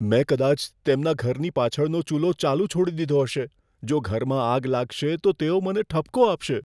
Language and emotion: Gujarati, fearful